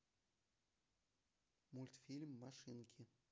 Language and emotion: Russian, neutral